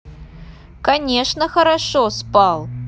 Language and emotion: Russian, neutral